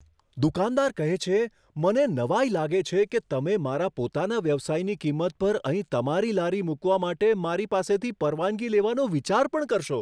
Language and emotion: Gujarati, surprised